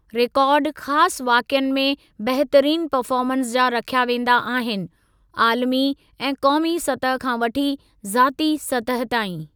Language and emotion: Sindhi, neutral